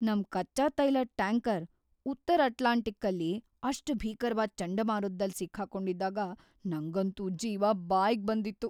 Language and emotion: Kannada, fearful